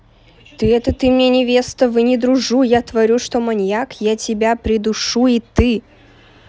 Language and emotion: Russian, angry